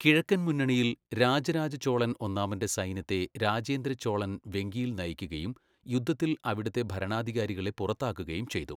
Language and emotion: Malayalam, neutral